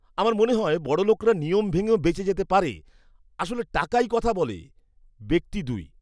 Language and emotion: Bengali, disgusted